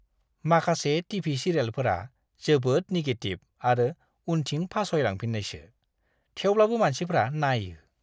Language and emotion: Bodo, disgusted